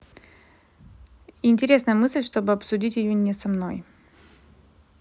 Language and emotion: Russian, neutral